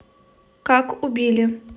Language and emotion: Russian, neutral